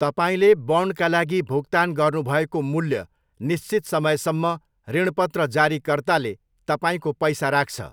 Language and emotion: Nepali, neutral